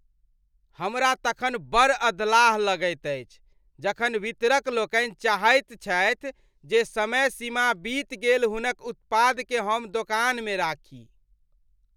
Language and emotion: Maithili, disgusted